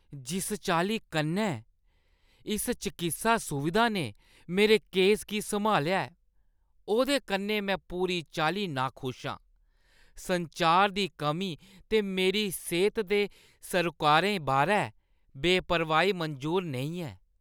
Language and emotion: Dogri, disgusted